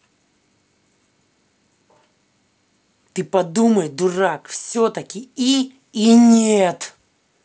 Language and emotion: Russian, angry